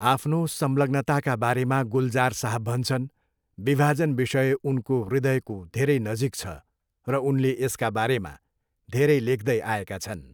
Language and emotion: Nepali, neutral